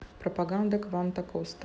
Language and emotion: Russian, neutral